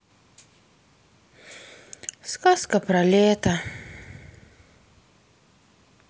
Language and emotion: Russian, sad